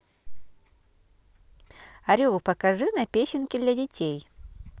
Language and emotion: Russian, positive